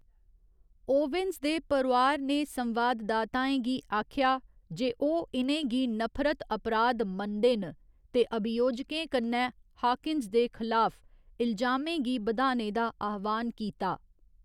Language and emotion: Dogri, neutral